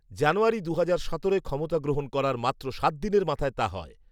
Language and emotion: Bengali, neutral